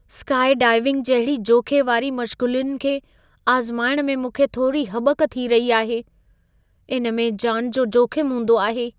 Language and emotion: Sindhi, fearful